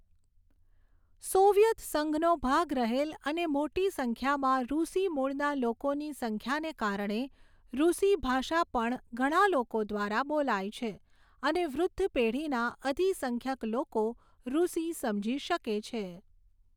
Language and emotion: Gujarati, neutral